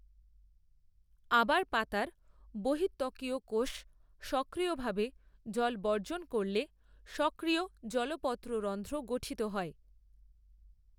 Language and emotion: Bengali, neutral